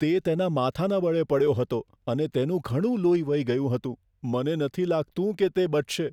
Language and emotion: Gujarati, fearful